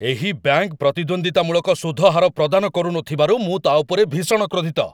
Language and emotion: Odia, angry